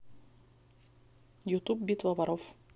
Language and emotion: Russian, neutral